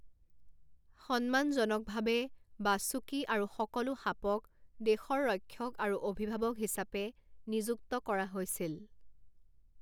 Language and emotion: Assamese, neutral